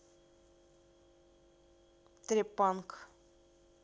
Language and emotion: Russian, neutral